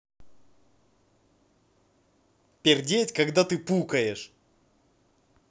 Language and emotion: Russian, angry